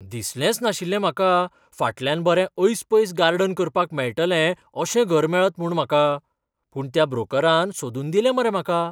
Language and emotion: Goan Konkani, surprised